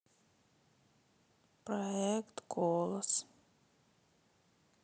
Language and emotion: Russian, sad